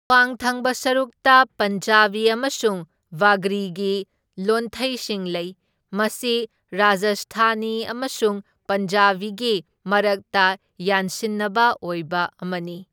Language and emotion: Manipuri, neutral